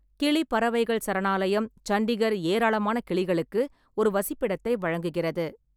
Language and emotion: Tamil, neutral